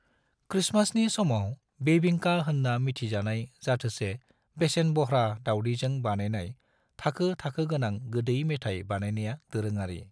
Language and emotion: Bodo, neutral